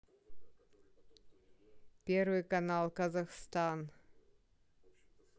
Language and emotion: Russian, neutral